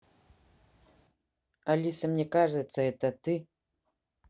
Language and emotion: Russian, neutral